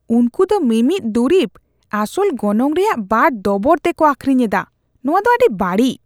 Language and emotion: Santali, disgusted